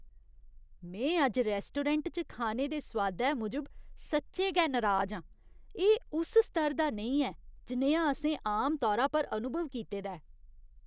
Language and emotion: Dogri, disgusted